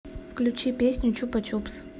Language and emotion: Russian, neutral